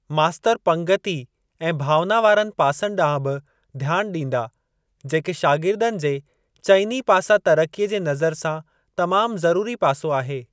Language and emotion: Sindhi, neutral